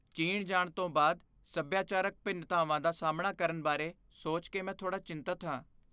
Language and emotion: Punjabi, fearful